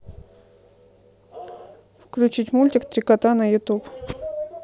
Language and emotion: Russian, neutral